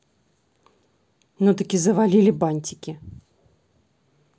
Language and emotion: Russian, angry